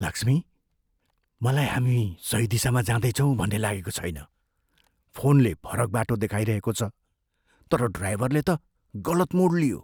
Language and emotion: Nepali, fearful